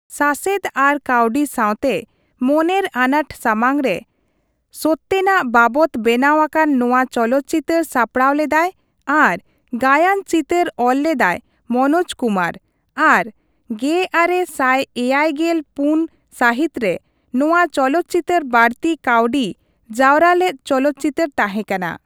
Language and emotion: Santali, neutral